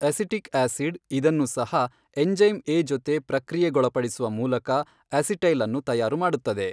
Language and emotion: Kannada, neutral